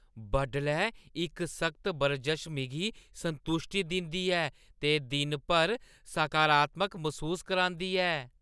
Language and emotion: Dogri, happy